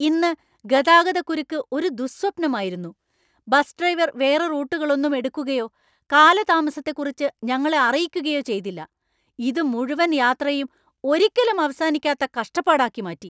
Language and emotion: Malayalam, angry